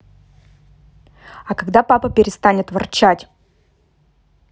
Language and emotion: Russian, angry